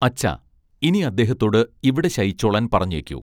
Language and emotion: Malayalam, neutral